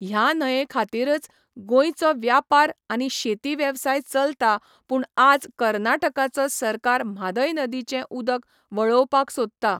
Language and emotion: Goan Konkani, neutral